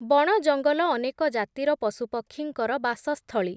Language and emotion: Odia, neutral